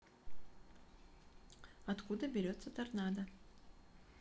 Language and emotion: Russian, neutral